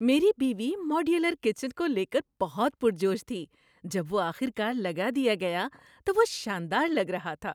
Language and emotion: Urdu, happy